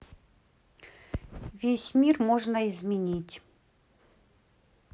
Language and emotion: Russian, neutral